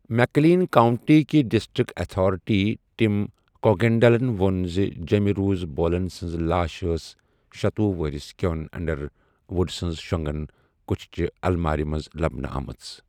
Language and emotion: Kashmiri, neutral